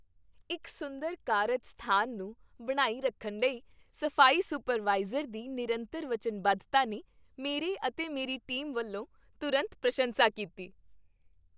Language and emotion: Punjabi, happy